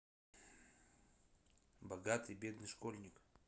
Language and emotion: Russian, neutral